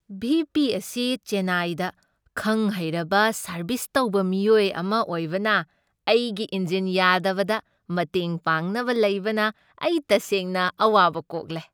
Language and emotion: Manipuri, happy